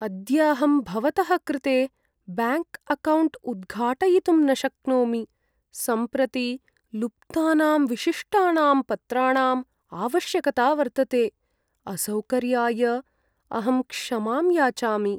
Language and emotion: Sanskrit, sad